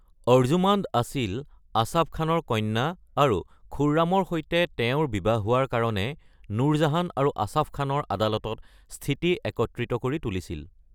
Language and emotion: Assamese, neutral